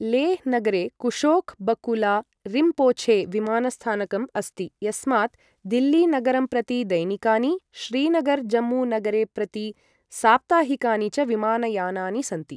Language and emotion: Sanskrit, neutral